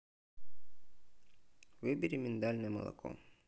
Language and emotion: Russian, neutral